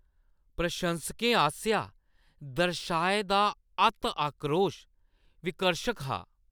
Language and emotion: Dogri, disgusted